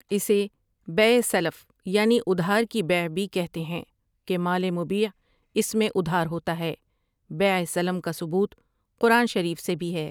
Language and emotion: Urdu, neutral